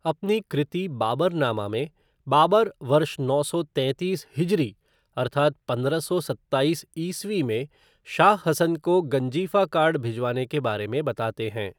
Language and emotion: Hindi, neutral